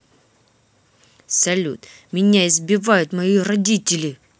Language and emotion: Russian, angry